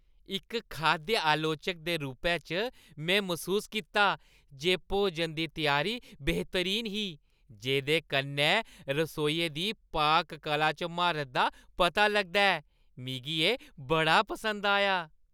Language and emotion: Dogri, happy